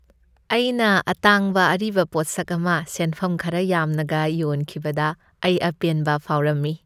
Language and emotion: Manipuri, happy